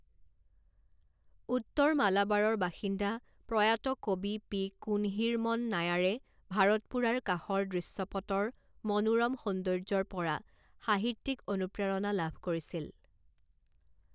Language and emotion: Assamese, neutral